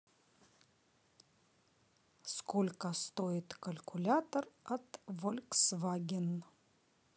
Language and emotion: Russian, neutral